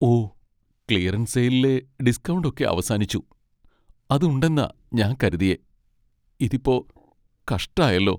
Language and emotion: Malayalam, sad